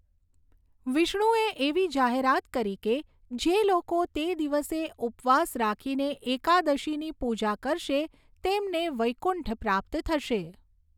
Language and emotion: Gujarati, neutral